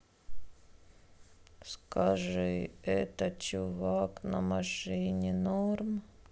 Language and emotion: Russian, sad